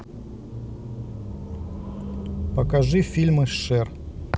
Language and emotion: Russian, neutral